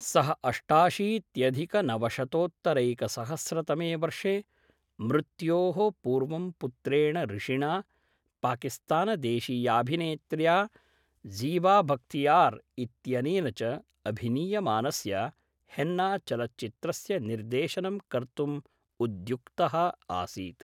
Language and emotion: Sanskrit, neutral